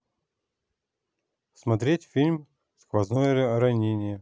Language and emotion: Russian, neutral